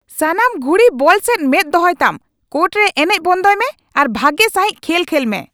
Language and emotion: Santali, angry